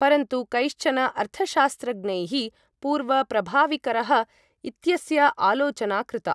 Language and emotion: Sanskrit, neutral